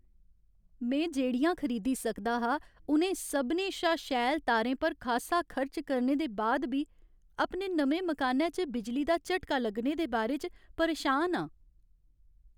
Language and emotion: Dogri, sad